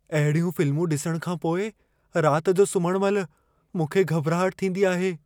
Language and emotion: Sindhi, fearful